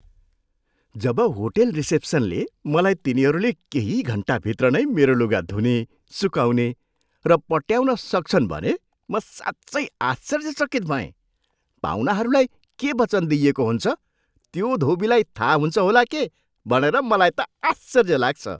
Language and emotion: Nepali, surprised